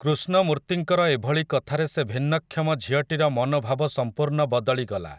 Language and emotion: Odia, neutral